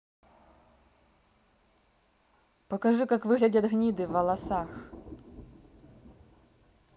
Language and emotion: Russian, neutral